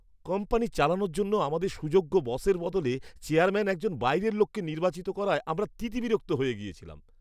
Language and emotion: Bengali, disgusted